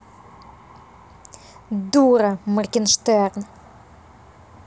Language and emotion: Russian, angry